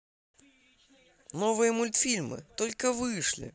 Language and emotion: Russian, positive